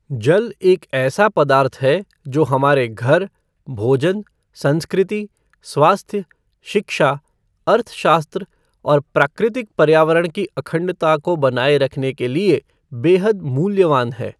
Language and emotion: Hindi, neutral